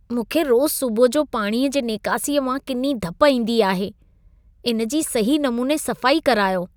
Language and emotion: Sindhi, disgusted